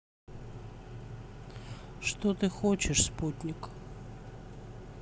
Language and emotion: Russian, neutral